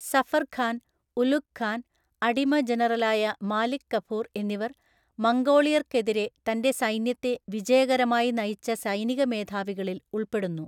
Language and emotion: Malayalam, neutral